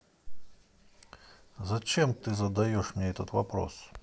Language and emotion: Russian, angry